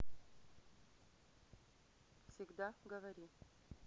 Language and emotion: Russian, neutral